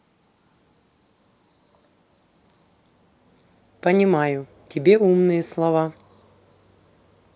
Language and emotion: Russian, neutral